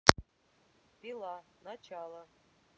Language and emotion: Russian, neutral